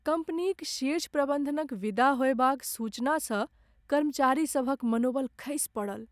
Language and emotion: Maithili, sad